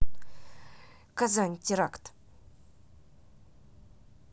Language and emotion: Russian, neutral